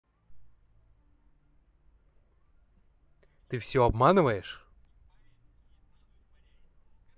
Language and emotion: Russian, neutral